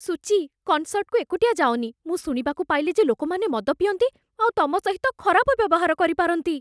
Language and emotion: Odia, fearful